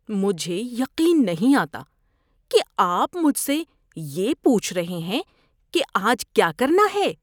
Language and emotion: Urdu, disgusted